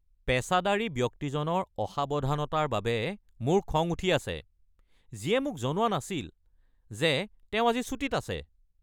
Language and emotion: Assamese, angry